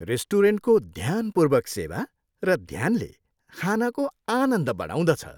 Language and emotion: Nepali, happy